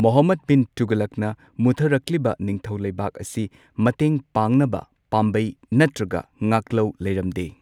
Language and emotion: Manipuri, neutral